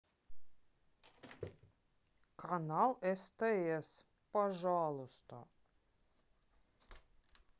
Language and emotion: Russian, neutral